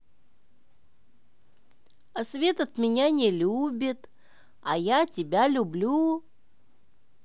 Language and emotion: Russian, positive